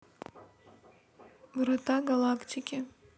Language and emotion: Russian, neutral